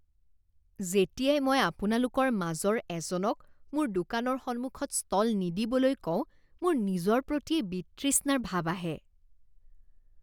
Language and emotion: Assamese, disgusted